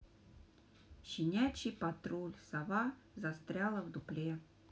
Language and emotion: Russian, neutral